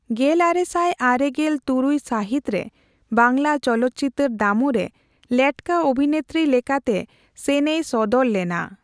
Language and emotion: Santali, neutral